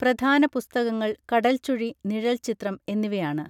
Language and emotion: Malayalam, neutral